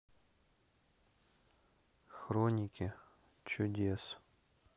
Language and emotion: Russian, neutral